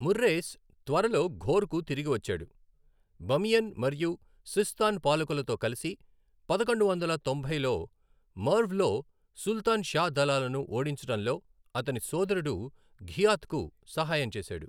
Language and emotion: Telugu, neutral